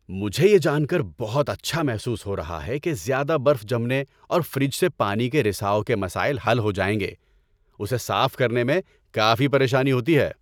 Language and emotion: Urdu, happy